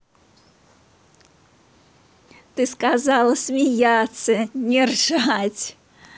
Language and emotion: Russian, positive